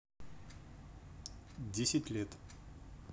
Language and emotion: Russian, neutral